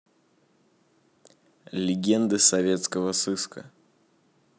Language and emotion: Russian, neutral